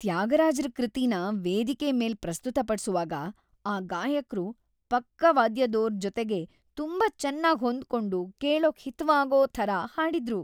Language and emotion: Kannada, happy